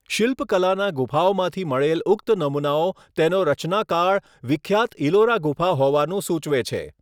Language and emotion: Gujarati, neutral